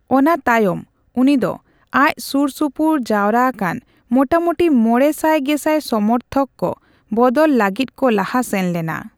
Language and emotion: Santali, neutral